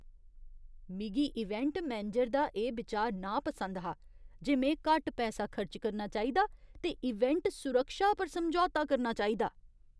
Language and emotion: Dogri, disgusted